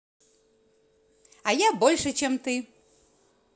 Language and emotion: Russian, positive